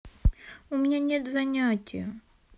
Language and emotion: Russian, sad